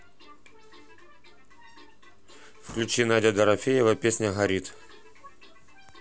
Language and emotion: Russian, neutral